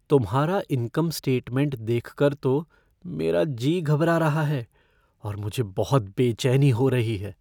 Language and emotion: Hindi, fearful